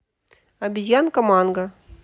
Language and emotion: Russian, neutral